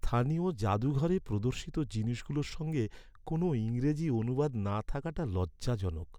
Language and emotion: Bengali, sad